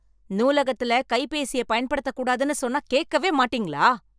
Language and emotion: Tamil, angry